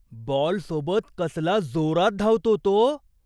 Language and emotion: Marathi, surprised